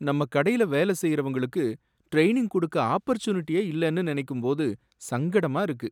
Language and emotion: Tamil, sad